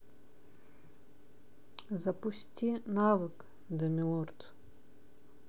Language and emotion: Russian, neutral